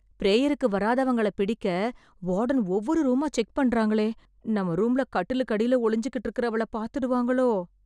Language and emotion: Tamil, fearful